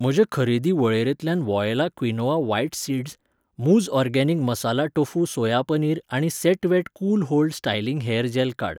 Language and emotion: Goan Konkani, neutral